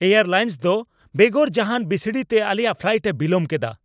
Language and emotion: Santali, angry